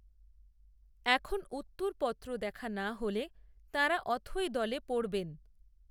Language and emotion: Bengali, neutral